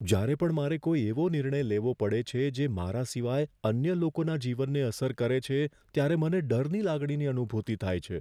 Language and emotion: Gujarati, fearful